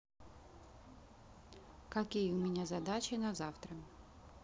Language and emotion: Russian, neutral